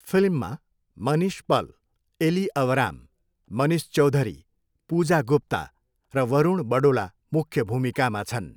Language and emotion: Nepali, neutral